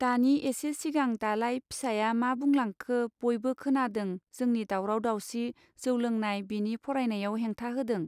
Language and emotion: Bodo, neutral